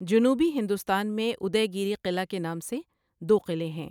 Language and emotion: Urdu, neutral